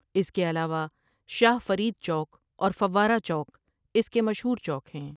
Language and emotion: Urdu, neutral